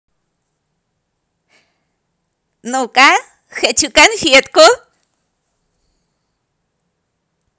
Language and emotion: Russian, positive